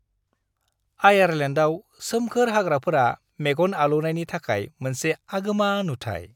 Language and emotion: Bodo, happy